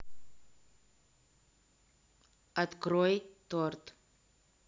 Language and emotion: Russian, neutral